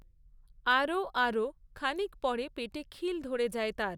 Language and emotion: Bengali, neutral